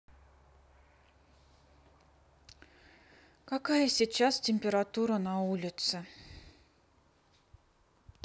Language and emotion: Russian, sad